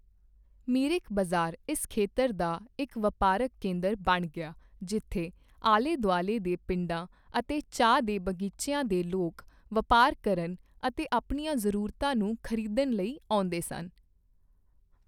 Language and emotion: Punjabi, neutral